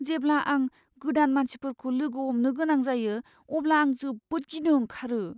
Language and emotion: Bodo, fearful